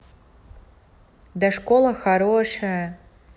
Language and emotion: Russian, positive